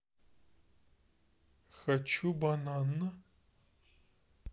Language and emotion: Russian, neutral